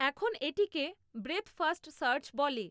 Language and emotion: Bengali, neutral